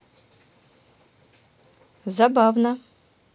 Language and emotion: Russian, positive